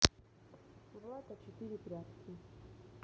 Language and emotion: Russian, neutral